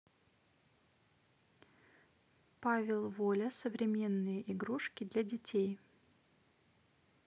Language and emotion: Russian, neutral